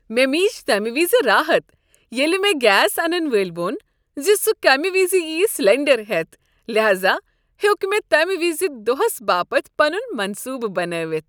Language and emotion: Kashmiri, happy